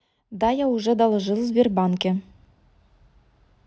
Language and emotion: Russian, angry